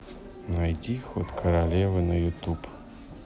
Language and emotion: Russian, neutral